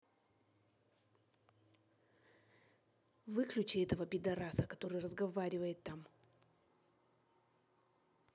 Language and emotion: Russian, angry